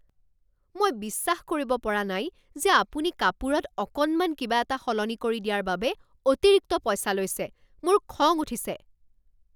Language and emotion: Assamese, angry